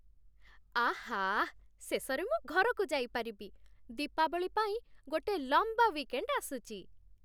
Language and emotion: Odia, happy